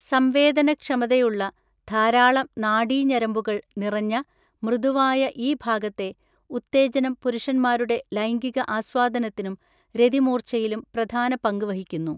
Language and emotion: Malayalam, neutral